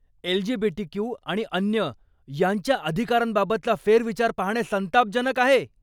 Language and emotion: Marathi, angry